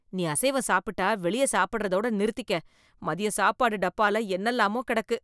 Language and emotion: Tamil, disgusted